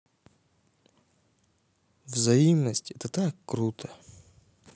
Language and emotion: Russian, neutral